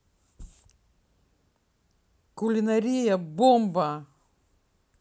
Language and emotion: Russian, positive